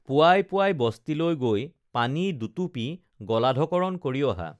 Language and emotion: Assamese, neutral